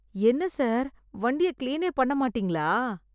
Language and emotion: Tamil, disgusted